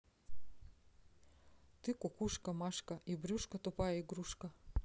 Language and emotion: Russian, neutral